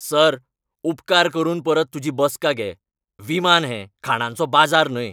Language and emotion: Goan Konkani, angry